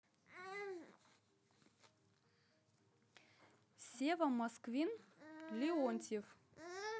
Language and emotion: Russian, neutral